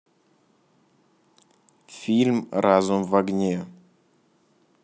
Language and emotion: Russian, neutral